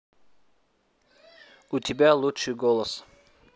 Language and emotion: Russian, neutral